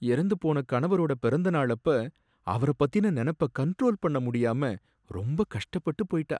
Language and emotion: Tamil, sad